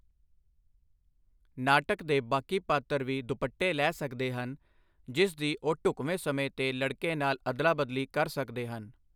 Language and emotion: Punjabi, neutral